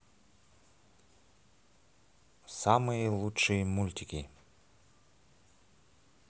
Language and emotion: Russian, positive